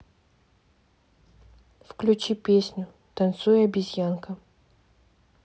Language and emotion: Russian, neutral